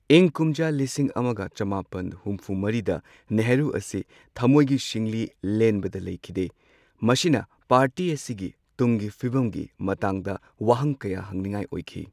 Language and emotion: Manipuri, neutral